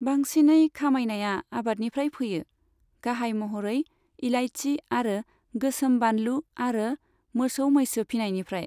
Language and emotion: Bodo, neutral